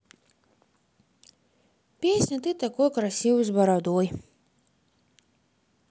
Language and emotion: Russian, neutral